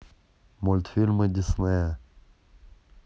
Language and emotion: Russian, neutral